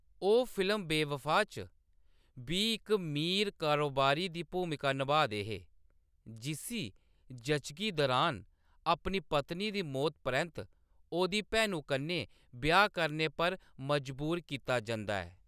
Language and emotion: Dogri, neutral